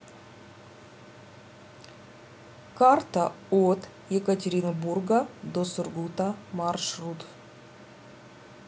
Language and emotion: Russian, neutral